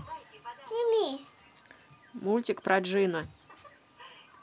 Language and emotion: Russian, neutral